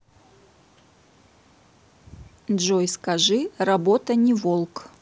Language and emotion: Russian, neutral